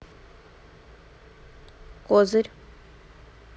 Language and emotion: Russian, neutral